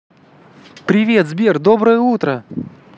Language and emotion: Russian, positive